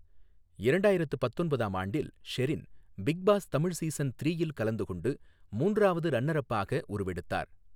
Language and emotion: Tamil, neutral